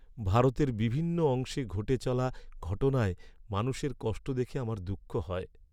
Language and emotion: Bengali, sad